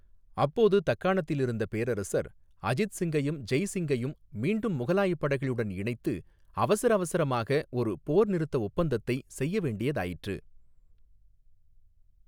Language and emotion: Tamil, neutral